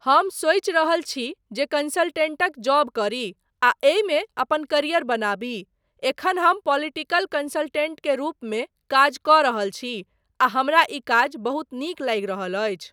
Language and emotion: Maithili, neutral